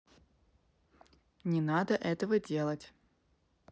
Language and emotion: Russian, neutral